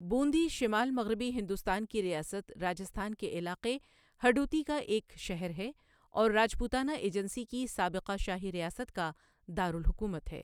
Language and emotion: Urdu, neutral